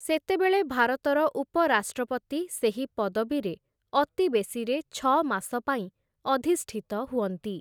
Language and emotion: Odia, neutral